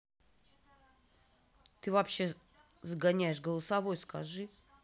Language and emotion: Russian, angry